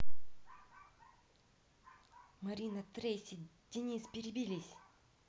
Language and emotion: Russian, neutral